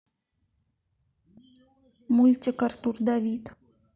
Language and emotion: Russian, neutral